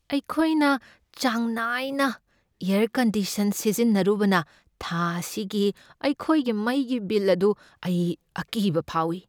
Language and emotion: Manipuri, fearful